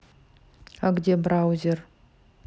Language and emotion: Russian, neutral